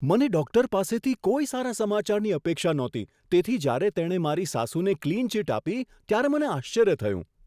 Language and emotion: Gujarati, surprised